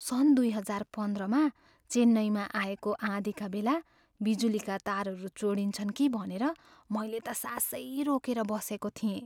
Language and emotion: Nepali, fearful